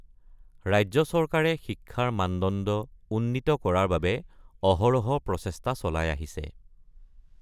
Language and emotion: Assamese, neutral